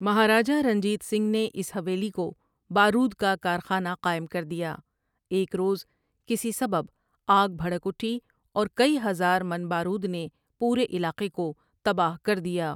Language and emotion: Urdu, neutral